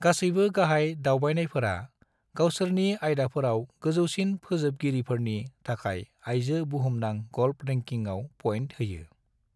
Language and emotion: Bodo, neutral